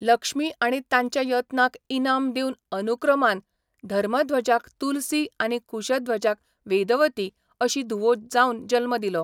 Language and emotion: Goan Konkani, neutral